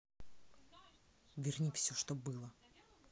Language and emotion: Russian, angry